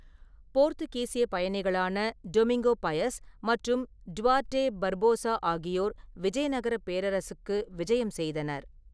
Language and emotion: Tamil, neutral